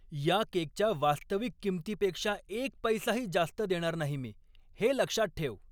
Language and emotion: Marathi, angry